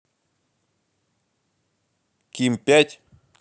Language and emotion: Russian, neutral